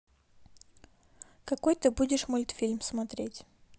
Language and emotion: Russian, neutral